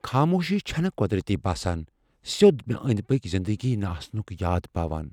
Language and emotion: Kashmiri, fearful